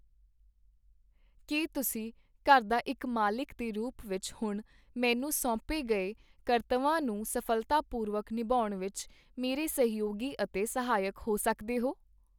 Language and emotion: Punjabi, neutral